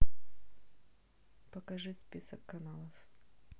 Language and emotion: Russian, neutral